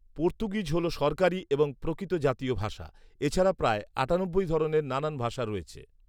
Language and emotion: Bengali, neutral